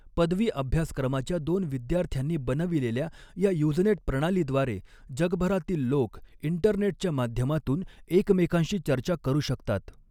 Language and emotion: Marathi, neutral